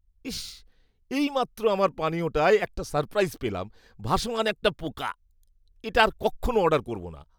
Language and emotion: Bengali, disgusted